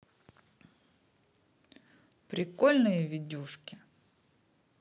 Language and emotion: Russian, positive